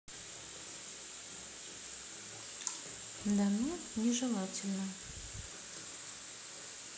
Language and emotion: Russian, neutral